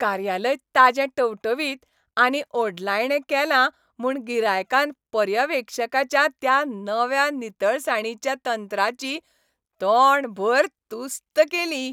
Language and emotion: Goan Konkani, happy